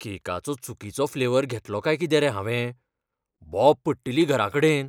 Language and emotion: Goan Konkani, fearful